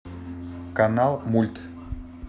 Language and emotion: Russian, neutral